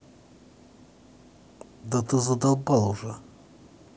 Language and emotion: Russian, angry